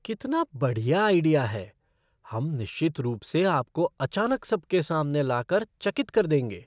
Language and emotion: Hindi, surprised